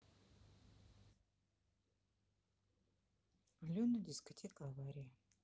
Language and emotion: Russian, neutral